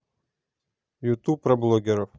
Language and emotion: Russian, neutral